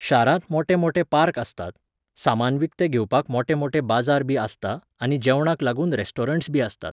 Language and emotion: Goan Konkani, neutral